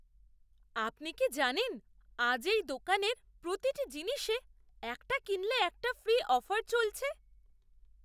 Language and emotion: Bengali, surprised